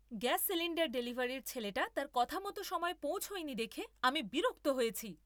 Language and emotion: Bengali, angry